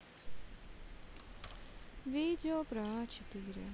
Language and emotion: Russian, sad